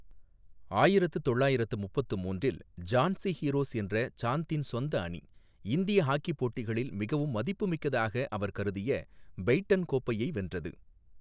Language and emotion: Tamil, neutral